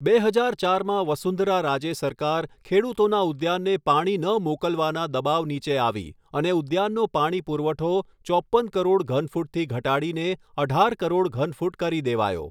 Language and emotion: Gujarati, neutral